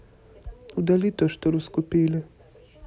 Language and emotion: Russian, neutral